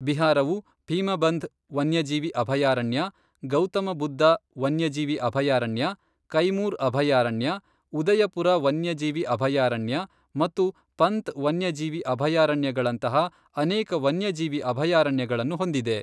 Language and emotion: Kannada, neutral